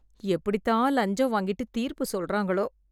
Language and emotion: Tamil, disgusted